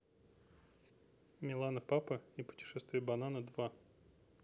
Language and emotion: Russian, neutral